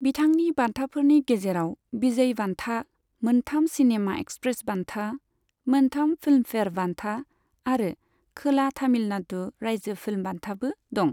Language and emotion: Bodo, neutral